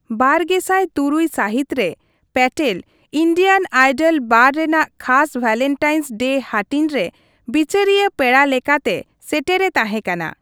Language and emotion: Santali, neutral